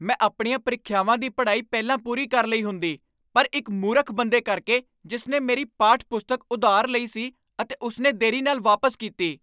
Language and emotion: Punjabi, angry